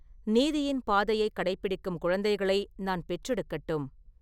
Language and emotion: Tamil, neutral